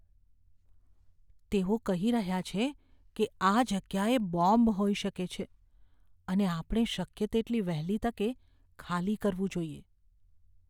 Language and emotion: Gujarati, fearful